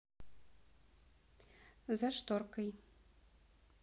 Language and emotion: Russian, neutral